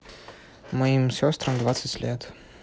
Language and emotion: Russian, neutral